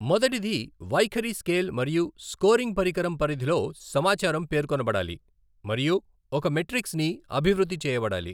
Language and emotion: Telugu, neutral